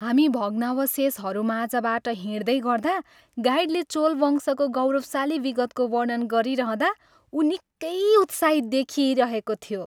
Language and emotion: Nepali, happy